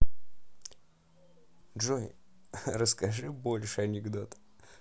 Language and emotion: Russian, positive